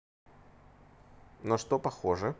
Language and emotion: Russian, neutral